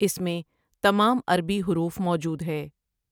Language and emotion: Urdu, neutral